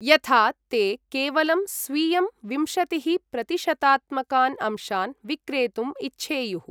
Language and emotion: Sanskrit, neutral